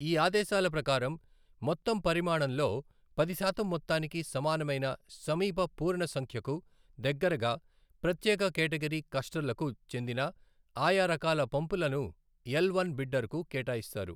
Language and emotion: Telugu, neutral